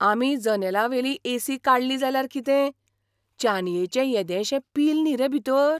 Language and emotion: Goan Konkani, surprised